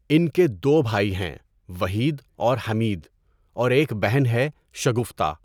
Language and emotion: Urdu, neutral